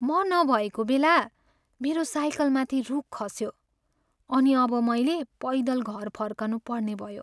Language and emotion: Nepali, sad